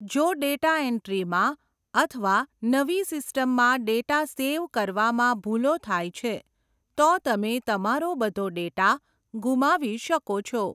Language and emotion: Gujarati, neutral